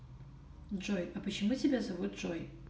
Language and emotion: Russian, neutral